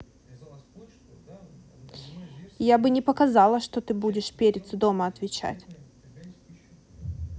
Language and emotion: Russian, angry